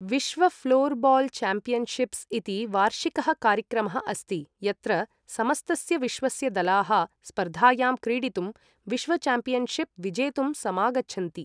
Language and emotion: Sanskrit, neutral